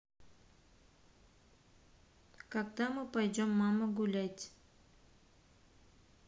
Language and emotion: Russian, neutral